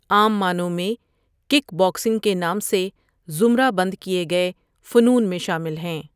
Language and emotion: Urdu, neutral